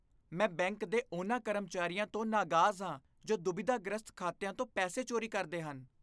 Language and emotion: Punjabi, disgusted